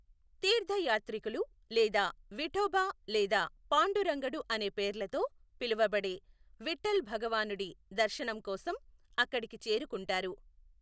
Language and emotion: Telugu, neutral